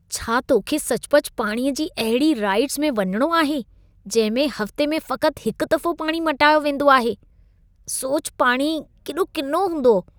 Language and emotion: Sindhi, disgusted